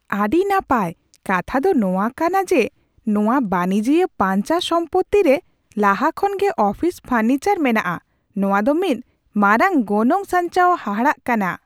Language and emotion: Santali, surprised